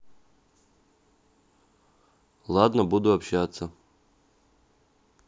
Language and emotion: Russian, neutral